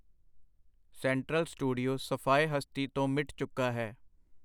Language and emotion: Punjabi, neutral